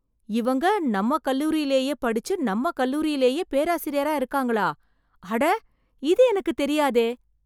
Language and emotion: Tamil, surprised